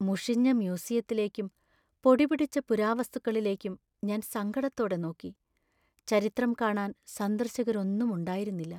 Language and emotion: Malayalam, sad